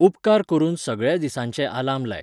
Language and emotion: Goan Konkani, neutral